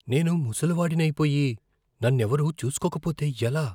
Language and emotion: Telugu, fearful